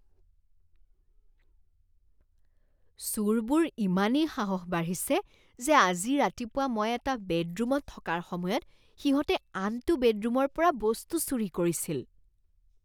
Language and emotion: Assamese, disgusted